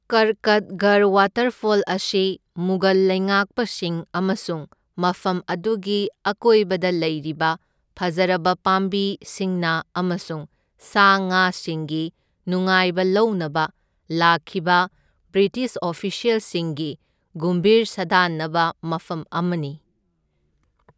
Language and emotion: Manipuri, neutral